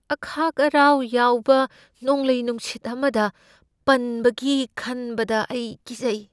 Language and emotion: Manipuri, fearful